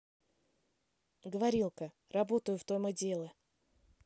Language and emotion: Russian, neutral